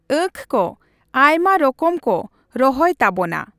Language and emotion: Santali, neutral